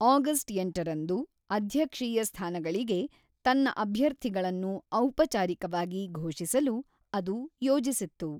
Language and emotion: Kannada, neutral